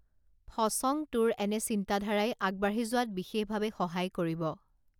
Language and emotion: Assamese, neutral